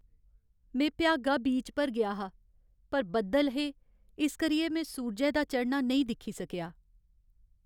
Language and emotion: Dogri, sad